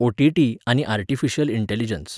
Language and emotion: Goan Konkani, neutral